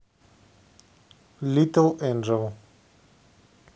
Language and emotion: Russian, neutral